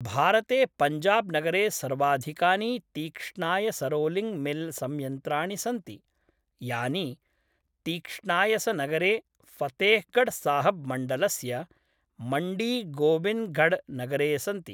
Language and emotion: Sanskrit, neutral